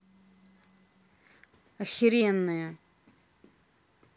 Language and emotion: Russian, angry